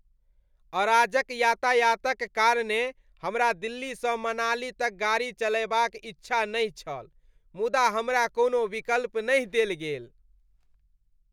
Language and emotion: Maithili, disgusted